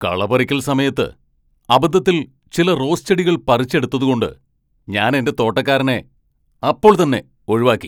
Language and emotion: Malayalam, angry